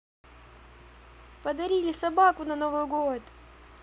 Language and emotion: Russian, positive